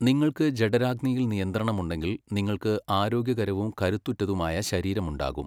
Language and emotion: Malayalam, neutral